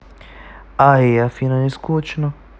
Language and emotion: Russian, neutral